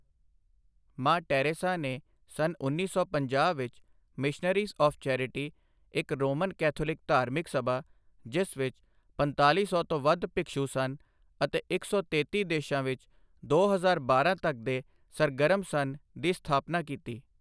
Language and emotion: Punjabi, neutral